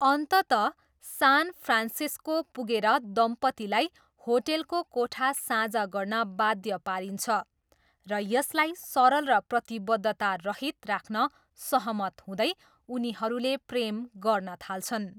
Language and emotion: Nepali, neutral